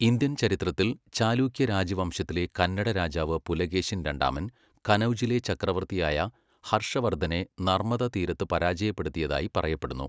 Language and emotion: Malayalam, neutral